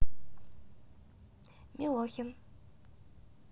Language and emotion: Russian, neutral